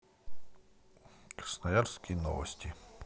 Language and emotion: Russian, neutral